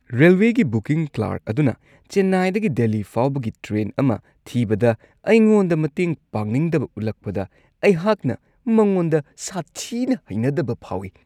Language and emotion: Manipuri, disgusted